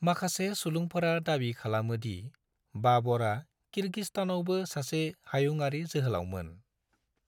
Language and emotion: Bodo, neutral